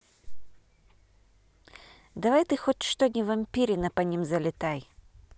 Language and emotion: Russian, neutral